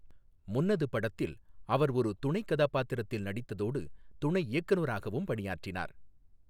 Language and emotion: Tamil, neutral